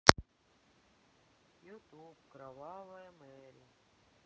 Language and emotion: Russian, sad